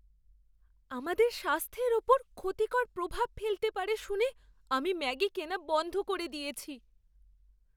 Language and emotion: Bengali, fearful